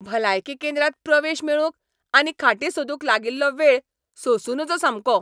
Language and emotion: Goan Konkani, angry